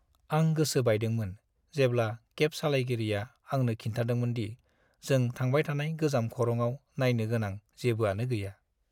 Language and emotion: Bodo, sad